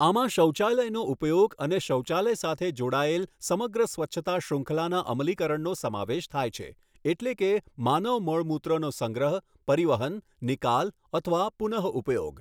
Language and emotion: Gujarati, neutral